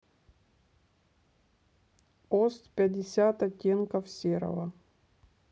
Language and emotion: Russian, neutral